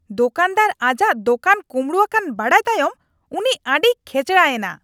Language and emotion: Santali, angry